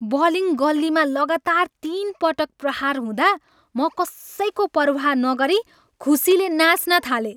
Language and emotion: Nepali, happy